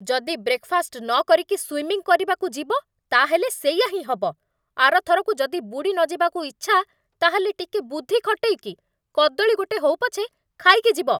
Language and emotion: Odia, angry